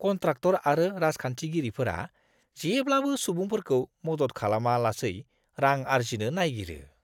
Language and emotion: Bodo, disgusted